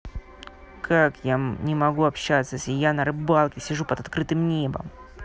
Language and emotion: Russian, angry